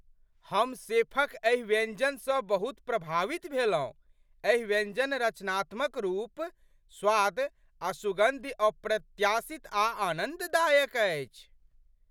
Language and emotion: Maithili, surprised